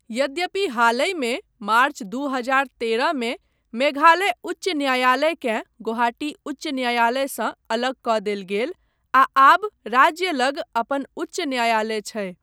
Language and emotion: Maithili, neutral